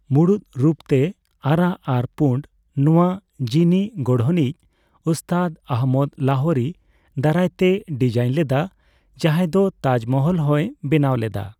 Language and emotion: Santali, neutral